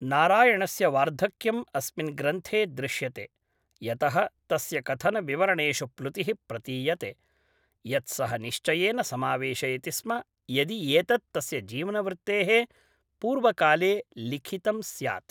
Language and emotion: Sanskrit, neutral